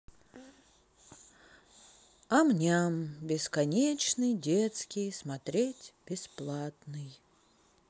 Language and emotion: Russian, sad